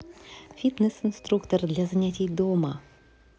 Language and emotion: Russian, positive